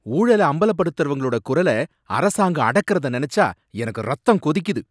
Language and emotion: Tamil, angry